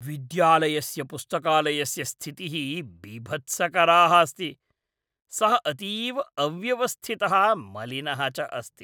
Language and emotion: Sanskrit, disgusted